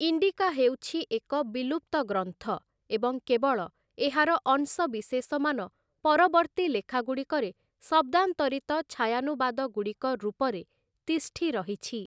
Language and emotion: Odia, neutral